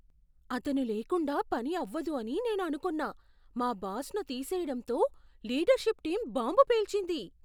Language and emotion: Telugu, surprised